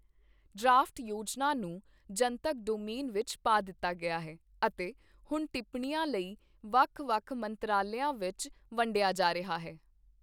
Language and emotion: Punjabi, neutral